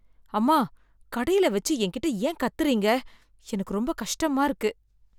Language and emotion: Tamil, sad